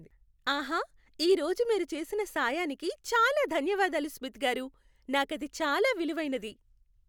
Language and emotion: Telugu, happy